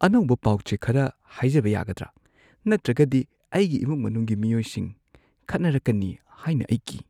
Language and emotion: Manipuri, fearful